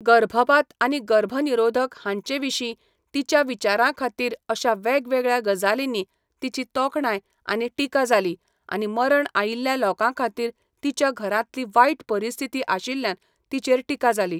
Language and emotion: Goan Konkani, neutral